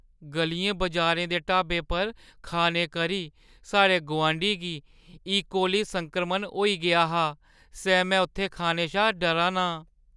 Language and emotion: Dogri, fearful